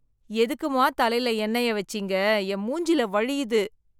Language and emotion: Tamil, disgusted